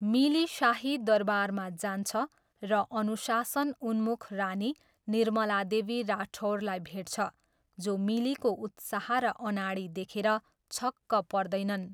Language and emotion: Nepali, neutral